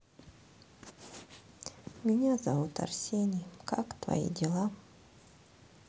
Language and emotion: Russian, sad